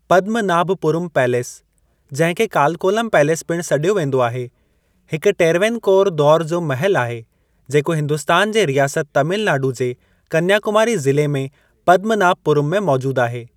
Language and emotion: Sindhi, neutral